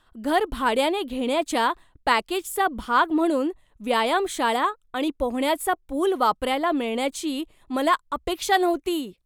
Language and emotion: Marathi, surprised